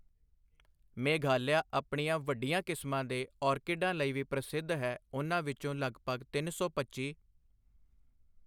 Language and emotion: Punjabi, neutral